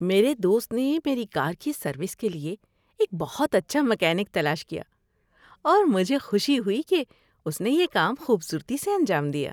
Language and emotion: Urdu, happy